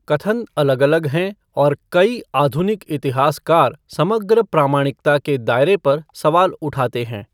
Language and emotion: Hindi, neutral